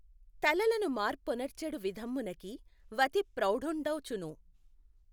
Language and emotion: Telugu, neutral